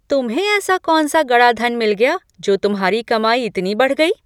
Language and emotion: Hindi, surprised